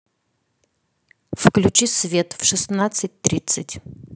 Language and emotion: Russian, neutral